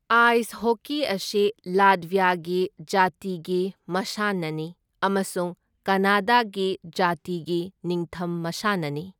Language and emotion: Manipuri, neutral